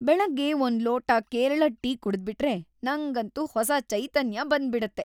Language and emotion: Kannada, happy